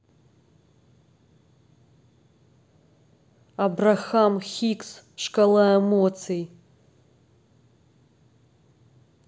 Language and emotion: Russian, angry